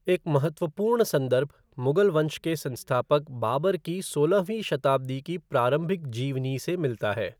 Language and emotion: Hindi, neutral